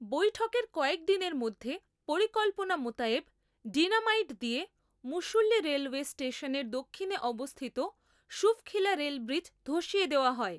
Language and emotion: Bengali, neutral